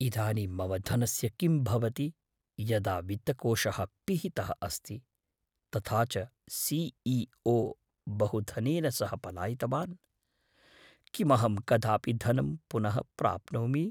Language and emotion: Sanskrit, fearful